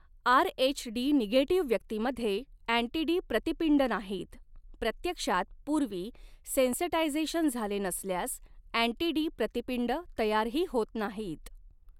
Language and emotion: Marathi, neutral